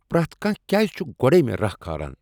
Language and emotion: Kashmiri, angry